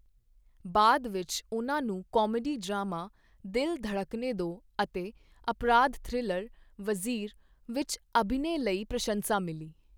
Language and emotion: Punjabi, neutral